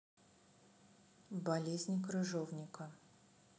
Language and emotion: Russian, neutral